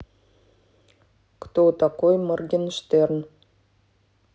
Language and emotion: Russian, neutral